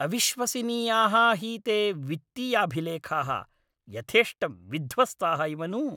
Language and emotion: Sanskrit, angry